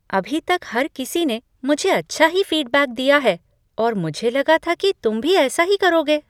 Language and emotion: Hindi, surprised